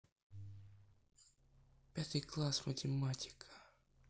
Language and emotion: Russian, neutral